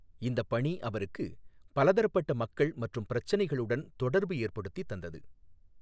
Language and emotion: Tamil, neutral